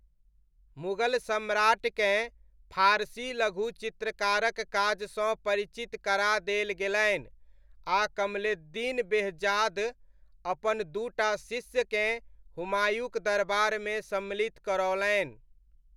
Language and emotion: Maithili, neutral